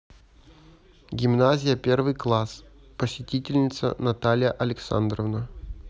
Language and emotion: Russian, neutral